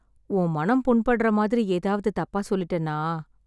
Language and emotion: Tamil, sad